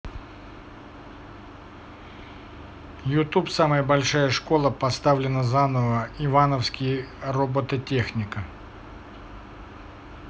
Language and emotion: Russian, neutral